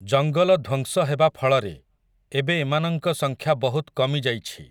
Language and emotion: Odia, neutral